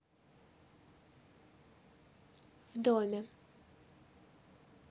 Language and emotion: Russian, neutral